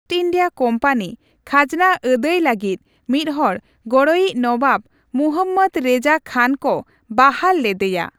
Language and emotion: Santali, neutral